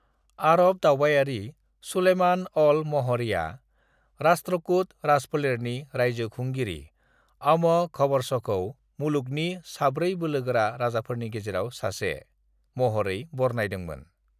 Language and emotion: Bodo, neutral